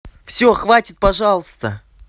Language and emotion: Russian, angry